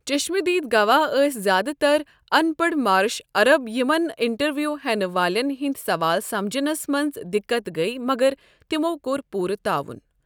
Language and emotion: Kashmiri, neutral